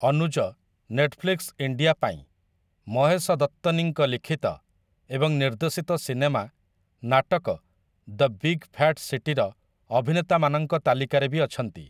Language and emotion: Odia, neutral